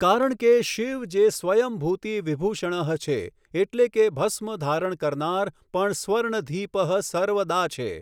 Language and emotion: Gujarati, neutral